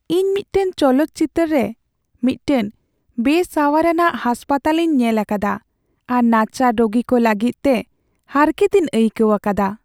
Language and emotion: Santali, sad